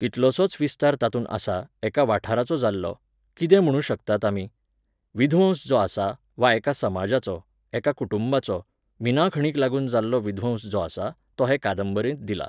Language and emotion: Goan Konkani, neutral